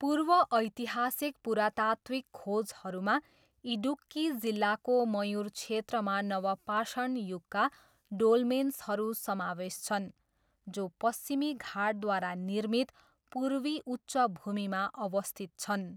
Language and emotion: Nepali, neutral